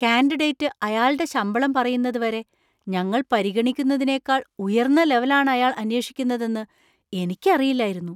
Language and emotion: Malayalam, surprised